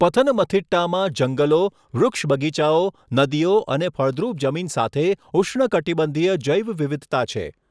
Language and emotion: Gujarati, neutral